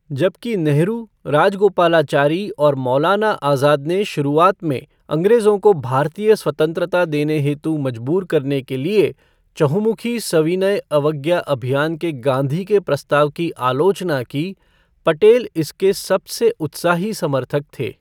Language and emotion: Hindi, neutral